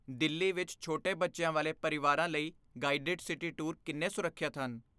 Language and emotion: Punjabi, fearful